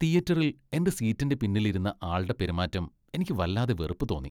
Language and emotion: Malayalam, disgusted